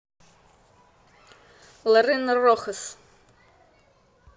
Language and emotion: Russian, positive